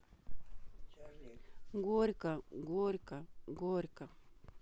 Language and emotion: Russian, sad